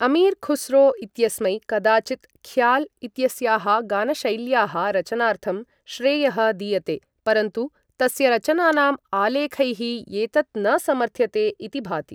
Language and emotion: Sanskrit, neutral